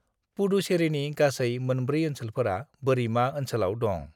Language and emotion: Bodo, neutral